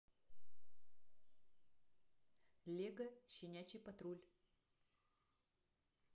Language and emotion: Russian, neutral